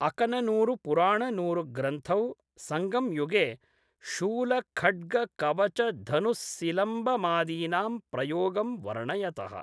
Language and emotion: Sanskrit, neutral